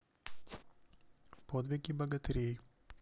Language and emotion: Russian, neutral